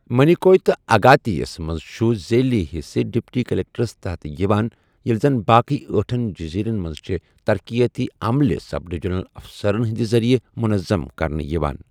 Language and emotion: Kashmiri, neutral